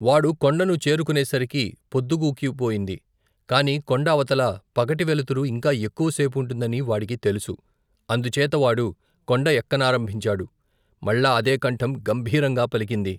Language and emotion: Telugu, neutral